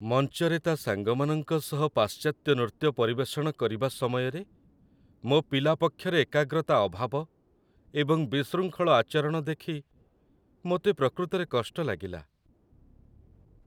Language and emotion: Odia, sad